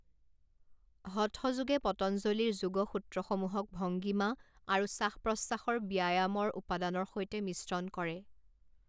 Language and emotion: Assamese, neutral